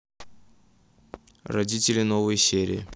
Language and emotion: Russian, neutral